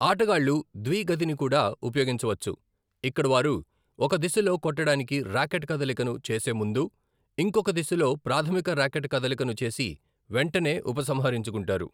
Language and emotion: Telugu, neutral